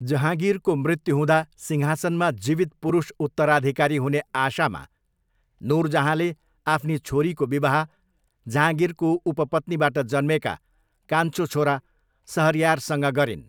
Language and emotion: Nepali, neutral